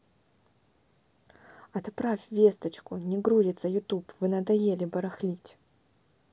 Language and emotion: Russian, neutral